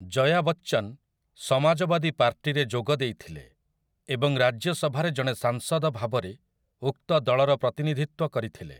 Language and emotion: Odia, neutral